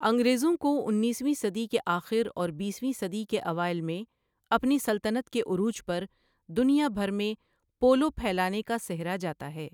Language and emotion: Urdu, neutral